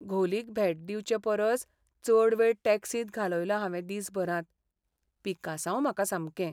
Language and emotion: Goan Konkani, sad